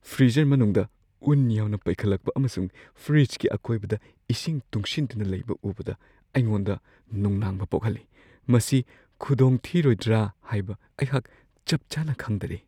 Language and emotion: Manipuri, fearful